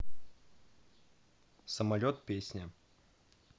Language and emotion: Russian, neutral